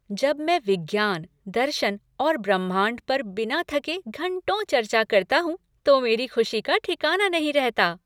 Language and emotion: Hindi, happy